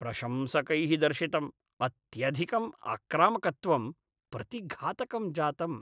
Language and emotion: Sanskrit, disgusted